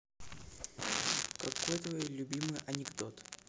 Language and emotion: Russian, neutral